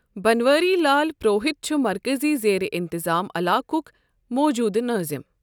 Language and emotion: Kashmiri, neutral